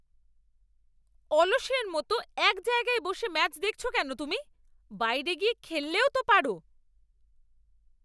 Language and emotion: Bengali, angry